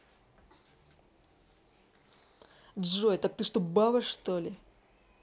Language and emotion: Russian, angry